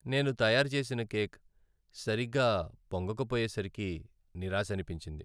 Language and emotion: Telugu, sad